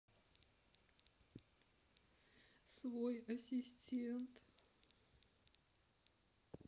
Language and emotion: Russian, sad